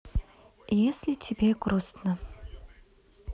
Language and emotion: Russian, neutral